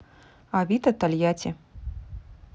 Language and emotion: Russian, neutral